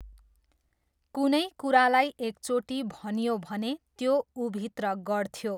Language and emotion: Nepali, neutral